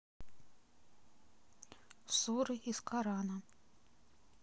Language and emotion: Russian, neutral